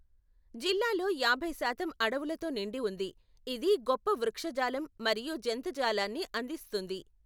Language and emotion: Telugu, neutral